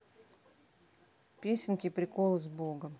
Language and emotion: Russian, neutral